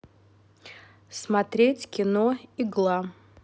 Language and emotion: Russian, neutral